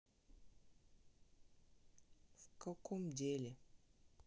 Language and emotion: Russian, sad